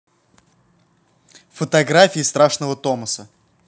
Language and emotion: Russian, neutral